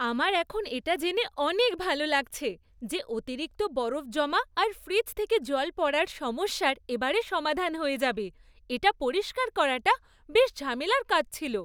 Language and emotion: Bengali, happy